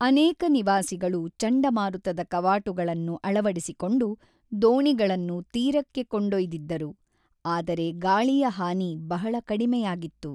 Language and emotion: Kannada, neutral